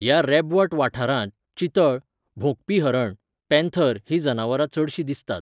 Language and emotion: Goan Konkani, neutral